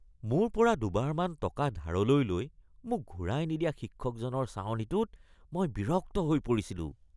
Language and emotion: Assamese, disgusted